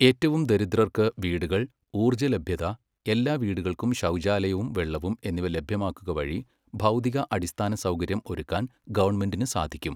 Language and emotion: Malayalam, neutral